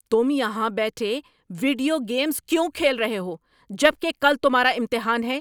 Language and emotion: Urdu, angry